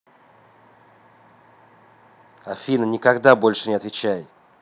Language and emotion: Russian, angry